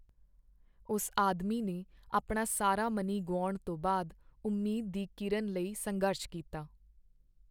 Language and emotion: Punjabi, sad